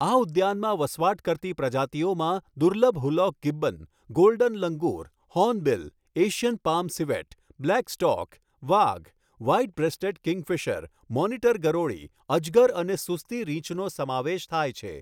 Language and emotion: Gujarati, neutral